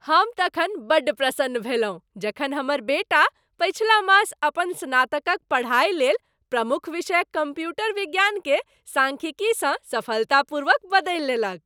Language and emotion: Maithili, happy